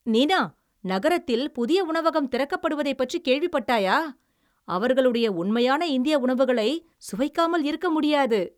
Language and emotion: Tamil, happy